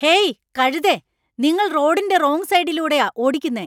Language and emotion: Malayalam, angry